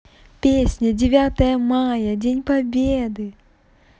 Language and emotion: Russian, positive